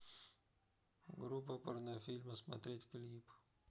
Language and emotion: Russian, neutral